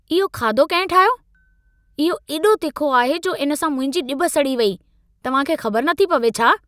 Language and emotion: Sindhi, angry